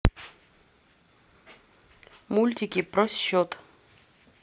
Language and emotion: Russian, neutral